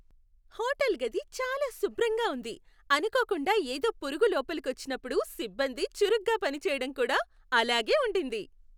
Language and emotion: Telugu, happy